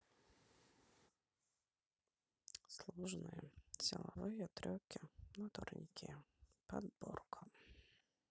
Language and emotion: Russian, sad